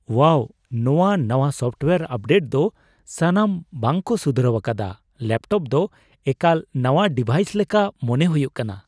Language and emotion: Santali, surprised